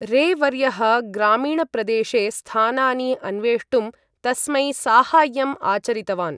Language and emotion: Sanskrit, neutral